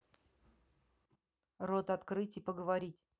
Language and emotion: Russian, angry